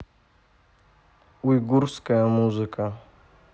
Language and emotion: Russian, neutral